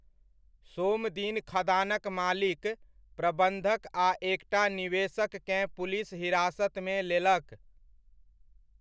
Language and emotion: Maithili, neutral